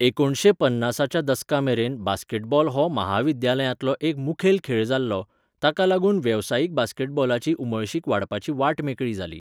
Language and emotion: Goan Konkani, neutral